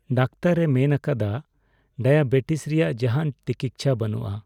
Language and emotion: Santali, sad